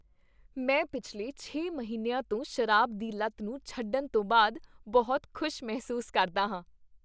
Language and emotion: Punjabi, happy